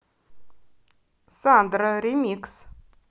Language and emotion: Russian, positive